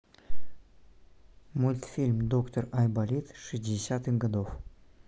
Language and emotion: Russian, neutral